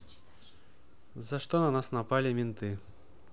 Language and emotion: Russian, neutral